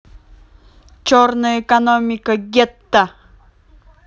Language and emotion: Russian, neutral